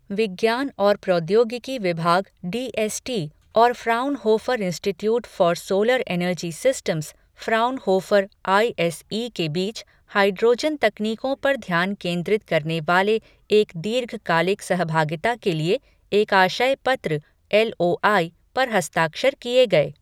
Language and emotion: Hindi, neutral